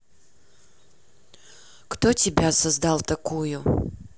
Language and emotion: Russian, neutral